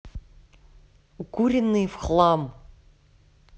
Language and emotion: Russian, angry